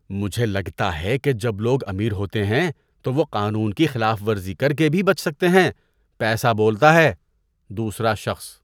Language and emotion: Urdu, disgusted